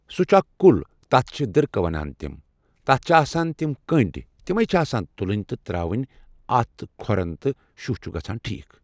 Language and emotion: Kashmiri, neutral